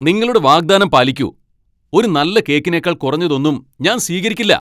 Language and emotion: Malayalam, angry